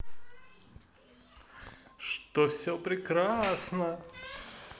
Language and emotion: Russian, positive